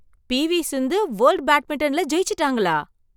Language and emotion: Tamil, surprised